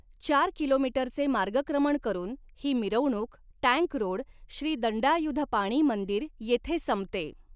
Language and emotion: Marathi, neutral